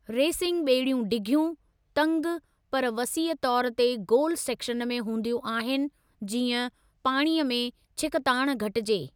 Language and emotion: Sindhi, neutral